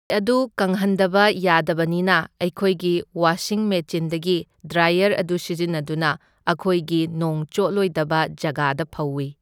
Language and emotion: Manipuri, neutral